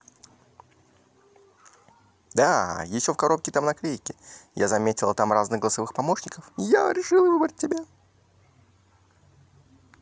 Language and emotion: Russian, positive